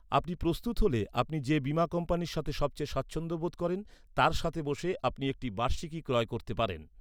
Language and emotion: Bengali, neutral